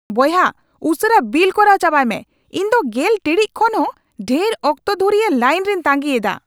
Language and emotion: Santali, angry